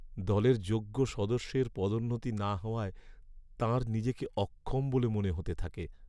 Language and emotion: Bengali, sad